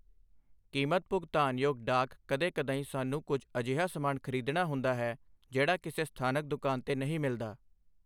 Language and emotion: Punjabi, neutral